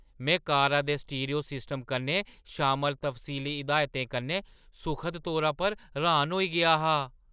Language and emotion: Dogri, surprised